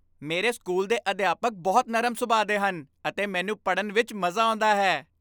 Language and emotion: Punjabi, happy